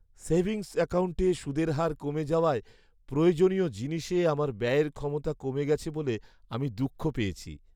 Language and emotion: Bengali, sad